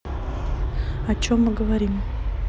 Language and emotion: Russian, neutral